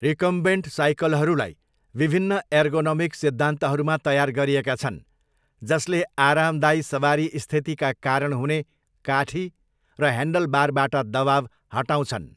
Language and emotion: Nepali, neutral